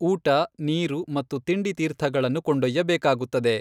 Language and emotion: Kannada, neutral